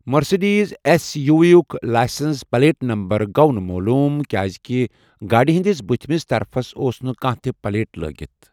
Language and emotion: Kashmiri, neutral